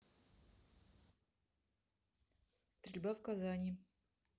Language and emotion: Russian, neutral